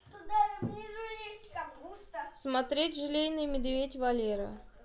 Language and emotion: Russian, neutral